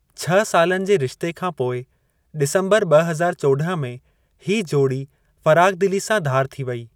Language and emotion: Sindhi, neutral